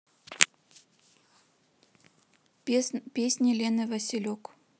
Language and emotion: Russian, neutral